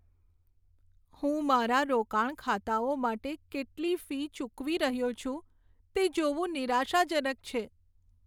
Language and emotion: Gujarati, sad